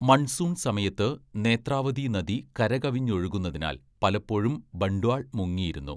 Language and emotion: Malayalam, neutral